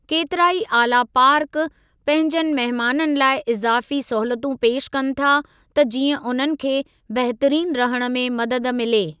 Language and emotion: Sindhi, neutral